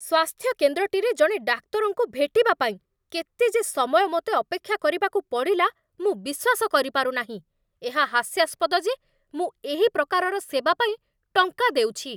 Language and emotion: Odia, angry